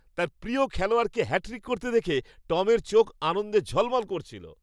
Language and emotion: Bengali, happy